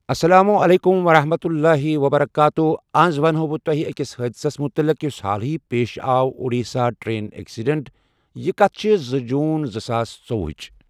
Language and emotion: Kashmiri, neutral